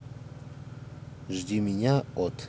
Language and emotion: Russian, neutral